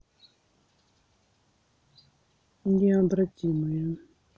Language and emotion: Russian, neutral